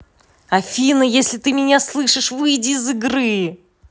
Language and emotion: Russian, angry